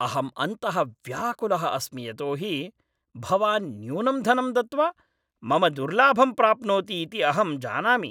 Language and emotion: Sanskrit, angry